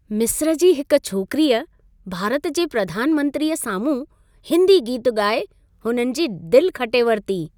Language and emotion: Sindhi, happy